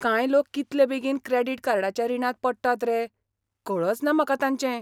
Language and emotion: Goan Konkani, surprised